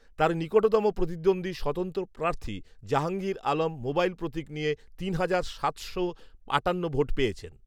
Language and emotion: Bengali, neutral